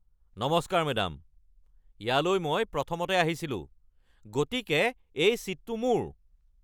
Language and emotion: Assamese, angry